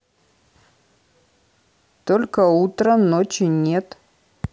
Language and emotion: Russian, neutral